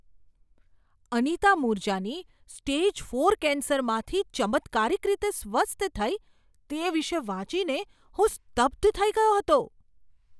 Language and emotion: Gujarati, surprised